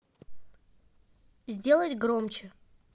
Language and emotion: Russian, neutral